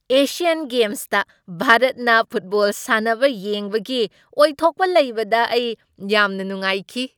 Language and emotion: Manipuri, happy